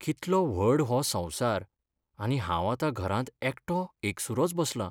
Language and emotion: Goan Konkani, sad